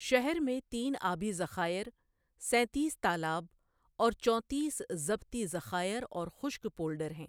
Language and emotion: Urdu, neutral